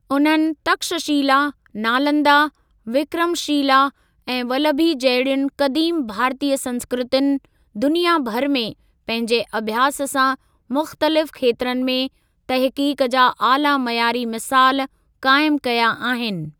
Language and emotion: Sindhi, neutral